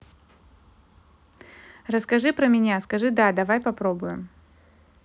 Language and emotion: Russian, neutral